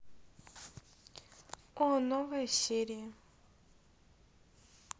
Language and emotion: Russian, neutral